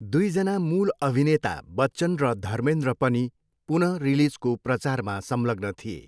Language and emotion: Nepali, neutral